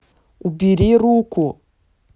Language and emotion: Russian, angry